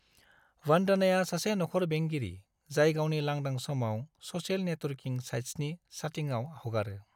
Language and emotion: Bodo, neutral